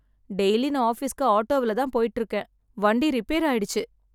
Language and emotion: Tamil, sad